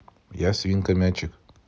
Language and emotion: Russian, neutral